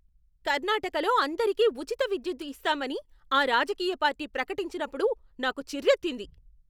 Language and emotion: Telugu, angry